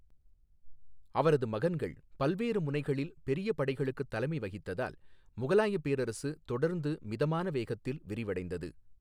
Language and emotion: Tamil, neutral